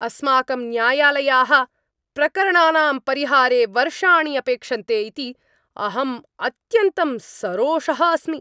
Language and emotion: Sanskrit, angry